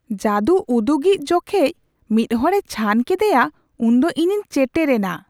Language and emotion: Santali, surprised